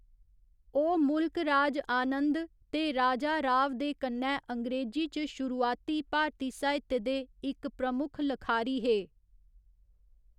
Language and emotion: Dogri, neutral